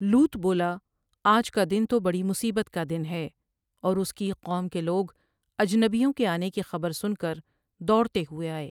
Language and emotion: Urdu, neutral